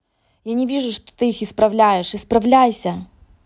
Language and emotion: Russian, angry